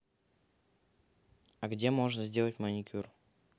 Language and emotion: Russian, neutral